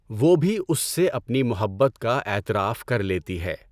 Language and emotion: Urdu, neutral